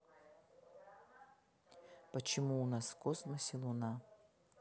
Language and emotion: Russian, neutral